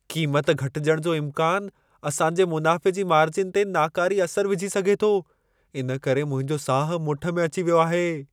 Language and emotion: Sindhi, fearful